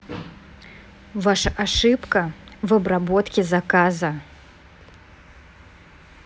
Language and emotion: Russian, angry